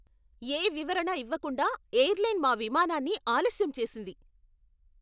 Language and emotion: Telugu, angry